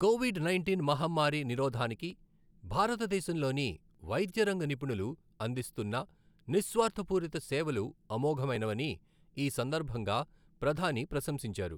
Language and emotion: Telugu, neutral